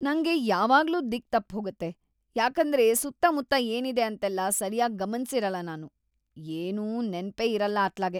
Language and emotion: Kannada, disgusted